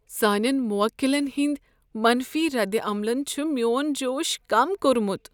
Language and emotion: Kashmiri, sad